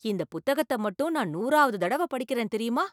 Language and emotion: Tamil, surprised